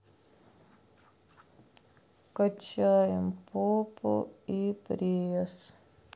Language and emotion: Russian, sad